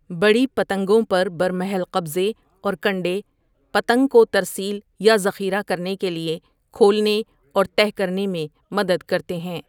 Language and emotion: Urdu, neutral